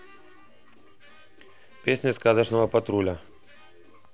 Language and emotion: Russian, neutral